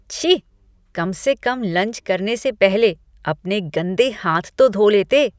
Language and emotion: Hindi, disgusted